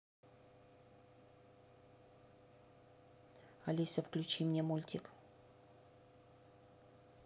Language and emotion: Russian, angry